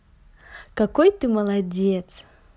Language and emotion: Russian, positive